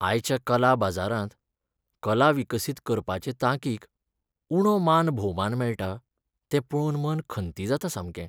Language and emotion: Goan Konkani, sad